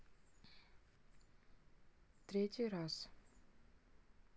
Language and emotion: Russian, neutral